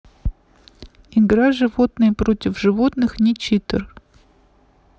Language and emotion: Russian, neutral